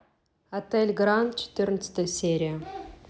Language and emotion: Russian, neutral